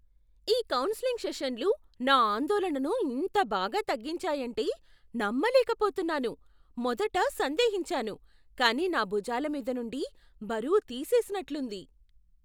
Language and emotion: Telugu, surprised